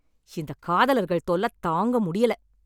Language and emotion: Tamil, angry